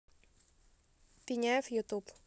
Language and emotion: Russian, neutral